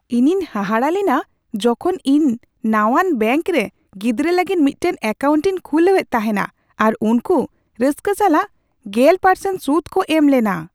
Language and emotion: Santali, surprised